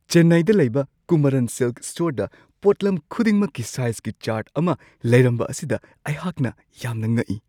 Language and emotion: Manipuri, surprised